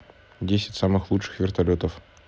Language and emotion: Russian, neutral